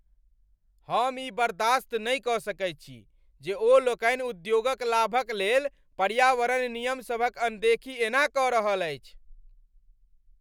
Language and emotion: Maithili, angry